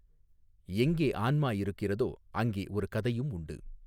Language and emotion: Tamil, neutral